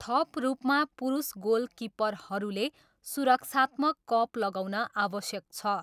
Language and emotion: Nepali, neutral